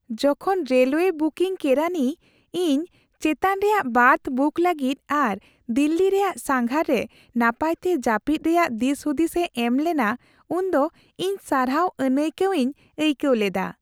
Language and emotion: Santali, happy